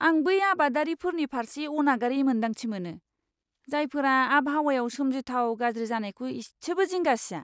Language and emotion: Bodo, disgusted